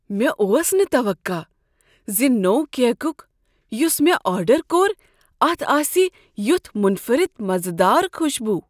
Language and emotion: Kashmiri, surprised